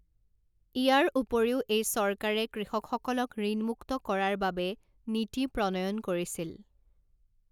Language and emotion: Assamese, neutral